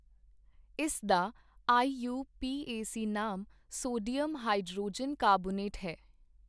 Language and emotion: Punjabi, neutral